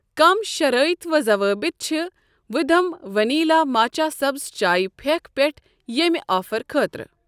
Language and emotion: Kashmiri, neutral